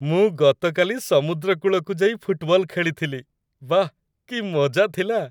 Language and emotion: Odia, happy